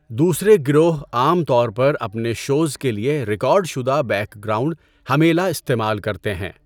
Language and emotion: Urdu, neutral